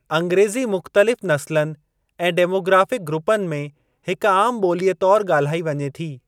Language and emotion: Sindhi, neutral